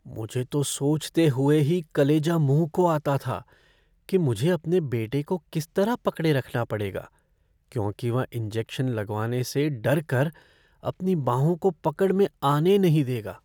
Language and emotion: Hindi, fearful